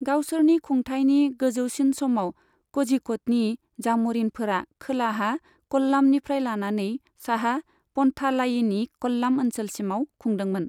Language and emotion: Bodo, neutral